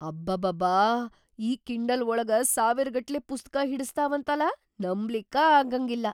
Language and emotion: Kannada, surprised